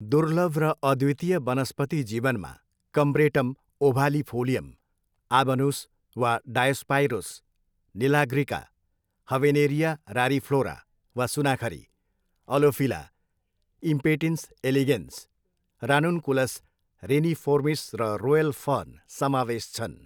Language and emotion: Nepali, neutral